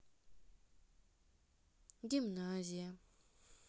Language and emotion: Russian, neutral